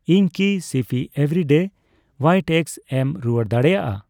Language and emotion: Santali, neutral